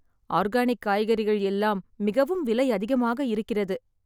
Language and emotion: Tamil, sad